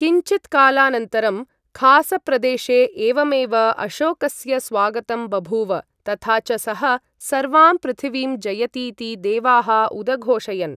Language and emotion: Sanskrit, neutral